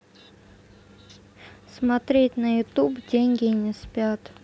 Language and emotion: Russian, neutral